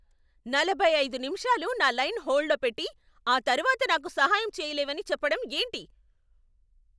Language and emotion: Telugu, angry